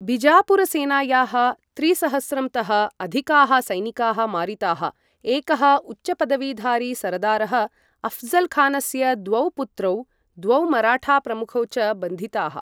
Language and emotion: Sanskrit, neutral